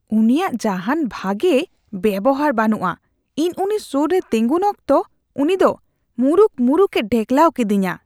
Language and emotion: Santali, disgusted